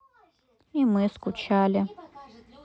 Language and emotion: Russian, sad